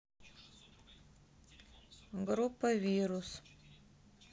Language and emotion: Russian, neutral